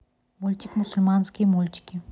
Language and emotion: Russian, neutral